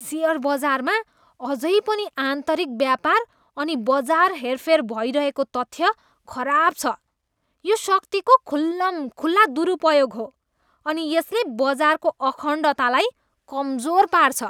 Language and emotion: Nepali, disgusted